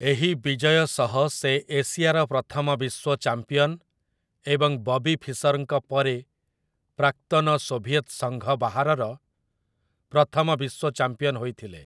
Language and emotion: Odia, neutral